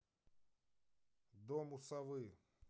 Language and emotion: Russian, neutral